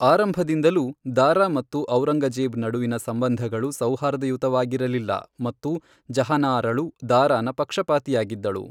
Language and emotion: Kannada, neutral